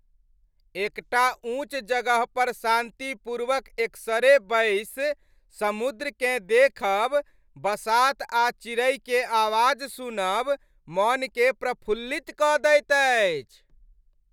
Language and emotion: Maithili, happy